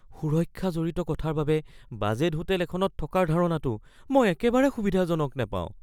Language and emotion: Assamese, fearful